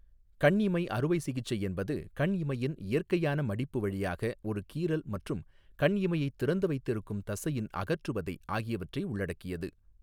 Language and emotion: Tamil, neutral